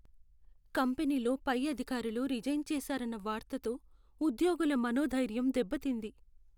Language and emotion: Telugu, sad